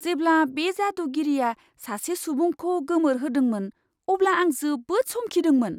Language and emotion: Bodo, surprised